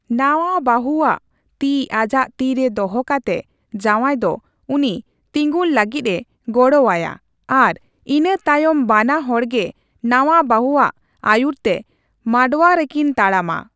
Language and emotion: Santali, neutral